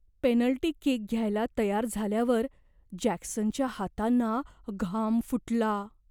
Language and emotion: Marathi, fearful